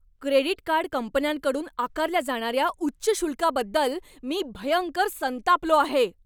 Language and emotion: Marathi, angry